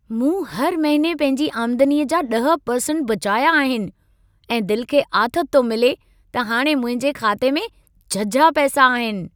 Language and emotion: Sindhi, happy